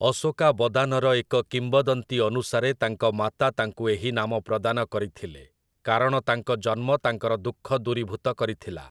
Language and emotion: Odia, neutral